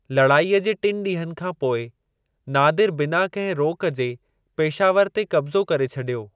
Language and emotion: Sindhi, neutral